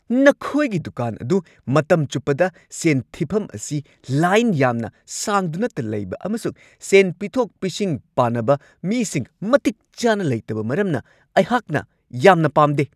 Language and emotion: Manipuri, angry